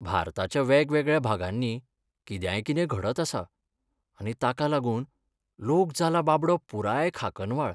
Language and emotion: Goan Konkani, sad